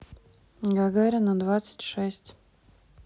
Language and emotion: Russian, neutral